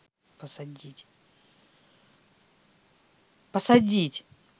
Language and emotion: Russian, angry